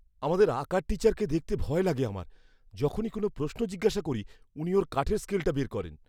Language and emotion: Bengali, fearful